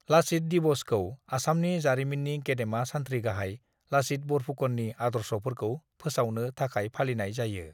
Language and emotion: Bodo, neutral